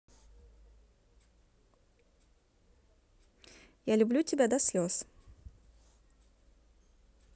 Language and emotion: Russian, neutral